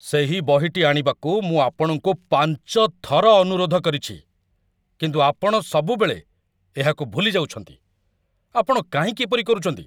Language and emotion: Odia, angry